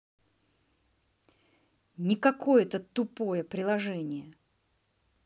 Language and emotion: Russian, angry